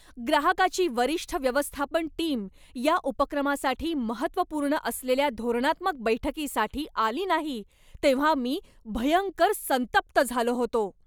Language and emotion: Marathi, angry